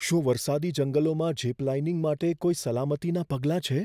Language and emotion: Gujarati, fearful